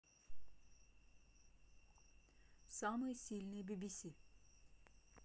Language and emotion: Russian, neutral